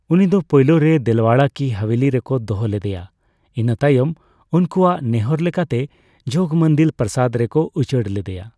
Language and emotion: Santali, neutral